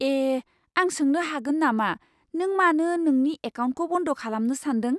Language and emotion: Bodo, surprised